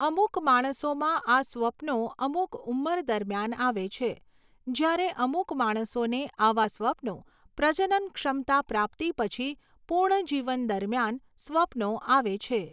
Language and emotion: Gujarati, neutral